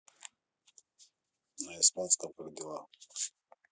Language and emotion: Russian, neutral